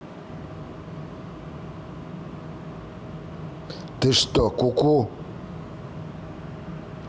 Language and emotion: Russian, angry